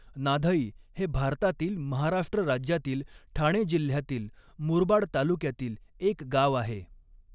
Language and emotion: Marathi, neutral